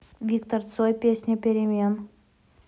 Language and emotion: Russian, neutral